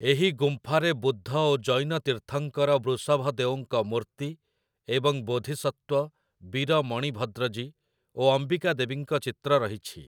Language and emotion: Odia, neutral